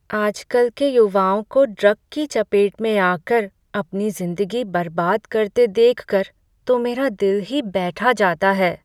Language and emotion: Hindi, sad